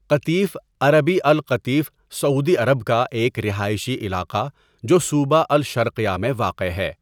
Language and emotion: Urdu, neutral